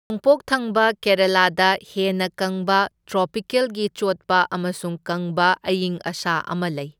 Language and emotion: Manipuri, neutral